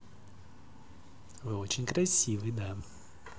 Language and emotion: Russian, positive